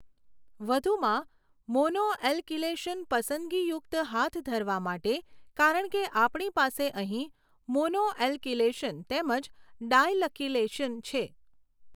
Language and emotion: Gujarati, neutral